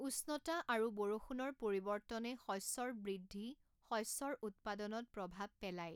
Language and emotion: Assamese, neutral